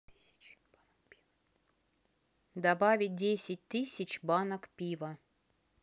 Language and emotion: Russian, neutral